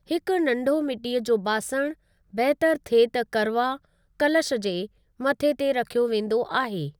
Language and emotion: Sindhi, neutral